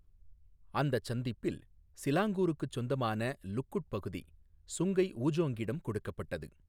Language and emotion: Tamil, neutral